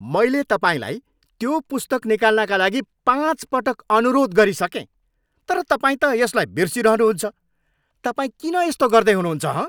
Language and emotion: Nepali, angry